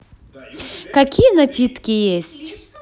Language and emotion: Russian, positive